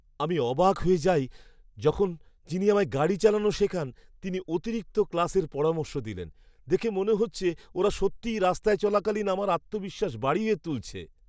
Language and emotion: Bengali, surprised